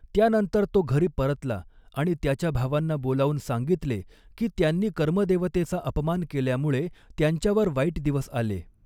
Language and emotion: Marathi, neutral